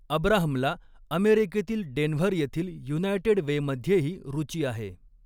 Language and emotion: Marathi, neutral